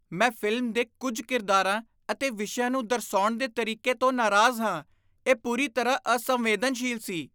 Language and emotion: Punjabi, disgusted